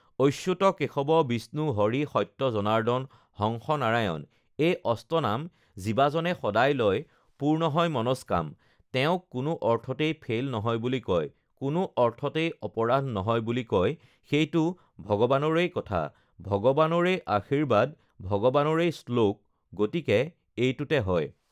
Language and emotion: Assamese, neutral